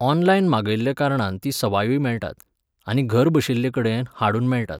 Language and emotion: Goan Konkani, neutral